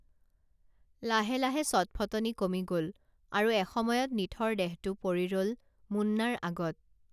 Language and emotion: Assamese, neutral